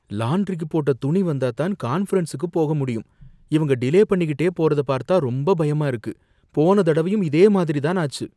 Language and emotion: Tamil, fearful